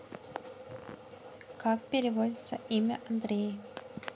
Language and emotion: Russian, neutral